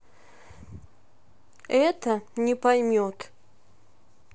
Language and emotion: Russian, angry